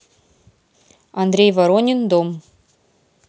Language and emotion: Russian, neutral